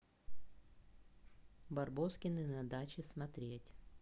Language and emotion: Russian, neutral